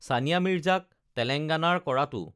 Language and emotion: Assamese, neutral